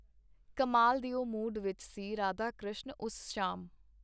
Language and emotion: Punjabi, neutral